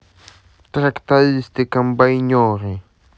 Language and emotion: Russian, neutral